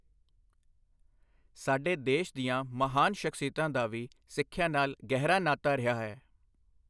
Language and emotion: Punjabi, neutral